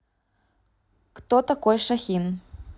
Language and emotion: Russian, neutral